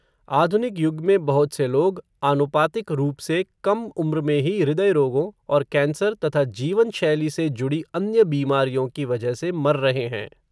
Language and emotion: Hindi, neutral